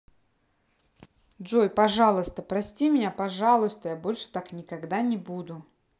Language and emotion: Russian, positive